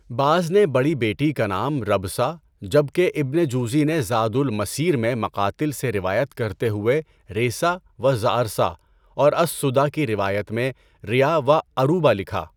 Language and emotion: Urdu, neutral